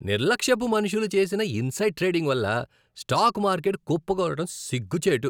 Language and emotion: Telugu, disgusted